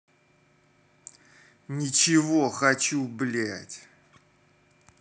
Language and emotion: Russian, angry